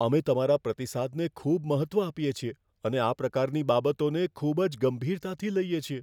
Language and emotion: Gujarati, fearful